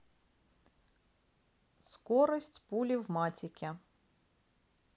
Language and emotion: Russian, neutral